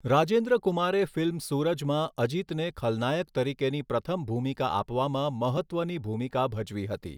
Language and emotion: Gujarati, neutral